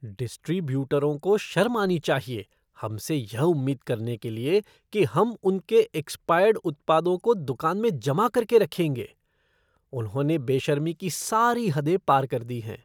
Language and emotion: Hindi, disgusted